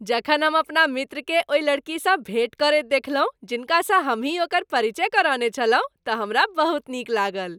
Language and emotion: Maithili, happy